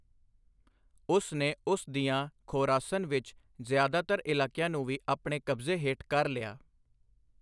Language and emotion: Punjabi, neutral